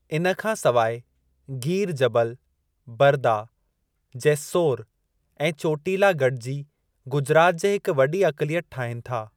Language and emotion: Sindhi, neutral